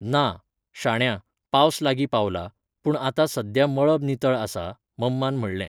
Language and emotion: Goan Konkani, neutral